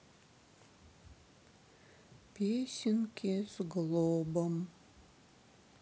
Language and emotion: Russian, sad